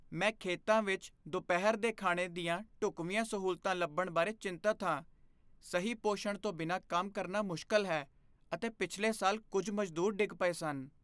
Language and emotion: Punjabi, fearful